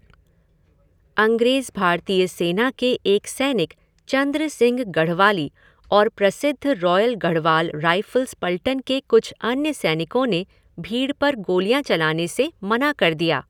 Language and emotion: Hindi, neutral